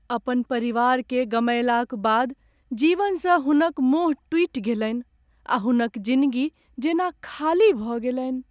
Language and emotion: Maithili, sad